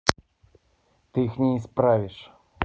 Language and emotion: Russian, neutral